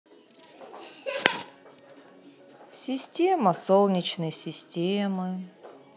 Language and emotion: Russian, sad